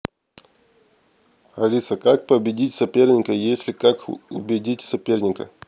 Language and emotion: Russian, neutral